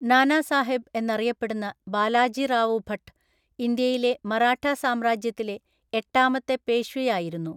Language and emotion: Malayalam, neutral